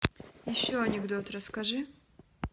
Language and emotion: Russian, neutral